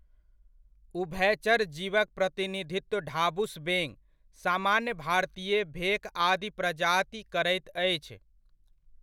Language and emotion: Maithili, neutral